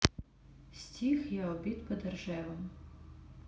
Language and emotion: Russian, neutral